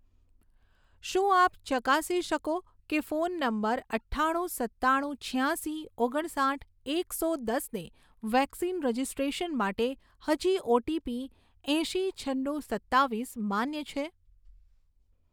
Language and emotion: Gujarati, neutral